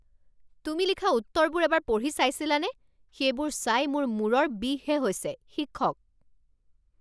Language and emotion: Assamese, angry